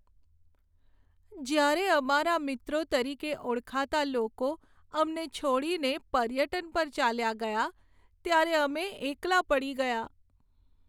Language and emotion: Gujarati, sad